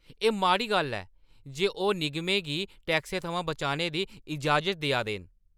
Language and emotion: Dogri, angry